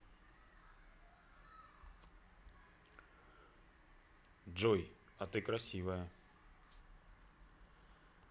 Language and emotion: Russian, neutral